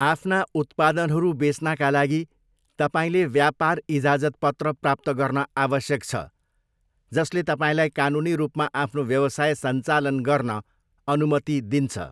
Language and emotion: Nepali, neutral